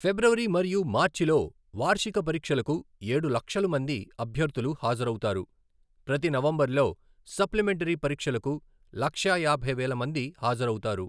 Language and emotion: Telugu, neutral